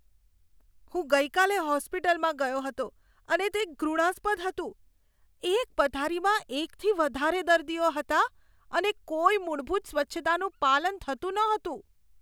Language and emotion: Gujarati, disgusted